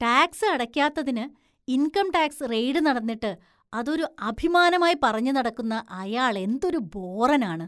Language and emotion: Malayalam, disgusted